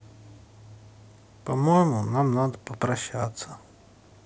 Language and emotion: Russian, sad